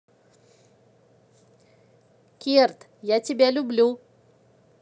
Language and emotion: Russian, positive